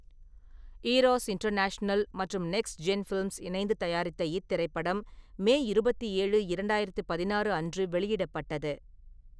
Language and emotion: Tamil, neutral